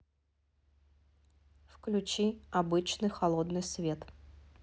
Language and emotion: Russian, neutral